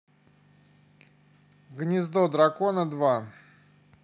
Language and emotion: Russian, neutral